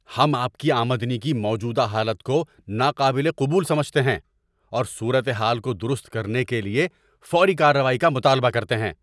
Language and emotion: Urdu, angry